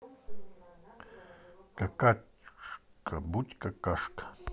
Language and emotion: Russian, neutral